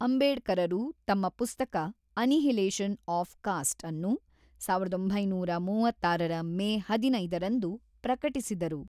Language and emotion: Kannada, neutral